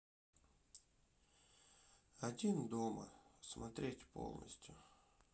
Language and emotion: Russian, sad